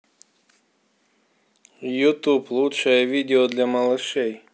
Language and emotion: Russian, neutral